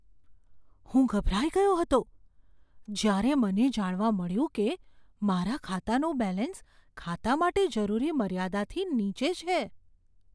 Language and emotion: Gujarati, fearful